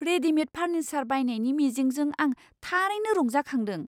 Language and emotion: Bodo, surprised